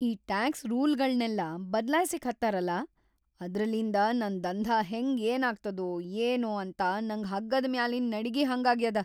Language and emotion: Kannada, fearful